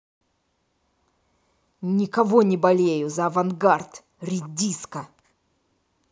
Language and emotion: Russian, angry